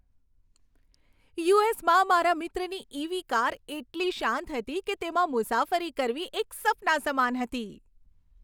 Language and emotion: Gujarati, happy